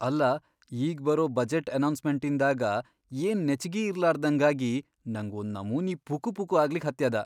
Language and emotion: Kannada, fearful